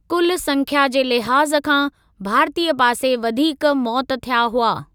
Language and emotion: Sindhi, neutral